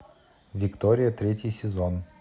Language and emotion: Russian, neutral